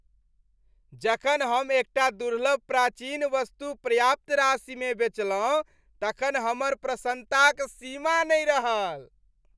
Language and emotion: Maithili, happy